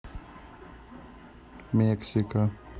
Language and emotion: Russian, neutral